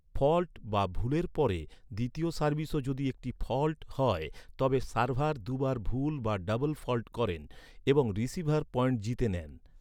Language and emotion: Bengali, neutral